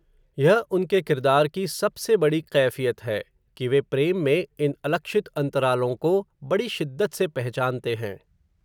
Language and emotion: Hindi, neutral